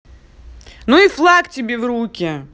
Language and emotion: Russian, angry